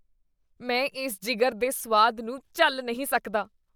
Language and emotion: Punjabi, disgusted